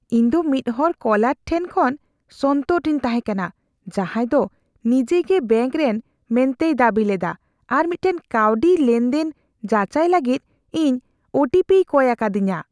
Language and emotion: Santali, fearful